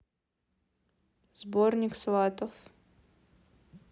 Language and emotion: Russian, neutral